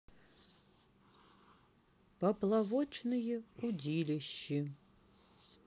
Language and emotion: Russian, sad